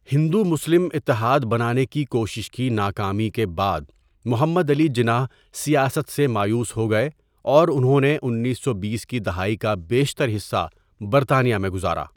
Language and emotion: Urdu, neutral